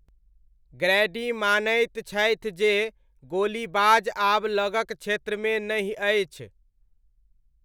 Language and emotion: Maithili, neutral